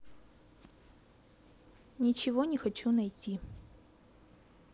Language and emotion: Russian, neutral